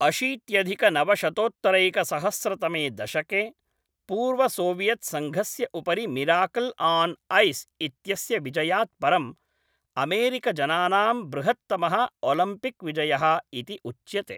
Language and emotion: Sanskrit, neutral